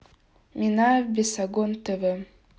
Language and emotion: Russian, neutral